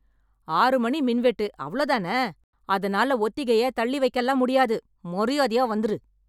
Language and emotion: Tamil, angry